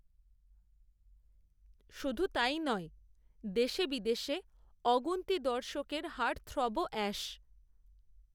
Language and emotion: Bengali, neutral